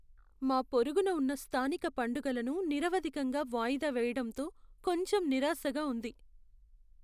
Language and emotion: Telugu, sad